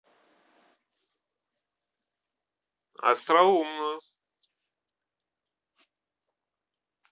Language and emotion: Russian, neutral